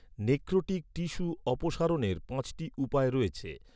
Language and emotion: Bengali, neutral